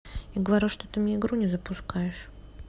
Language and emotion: Russian, neutral